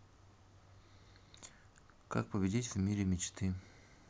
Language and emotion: Russian, neutral